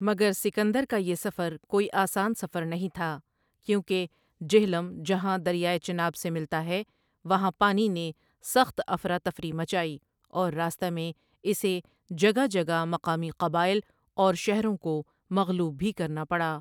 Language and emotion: Urdu, neutral